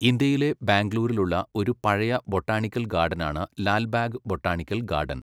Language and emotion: Malayalam, neutral